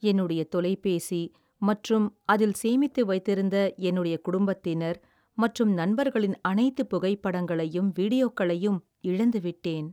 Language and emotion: Tamil, sad